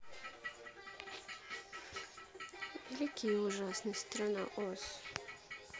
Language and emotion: Russian, sad